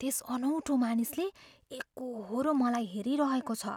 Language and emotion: Nepali, fearful